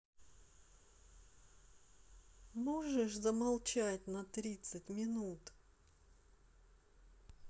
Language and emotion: Russian, angry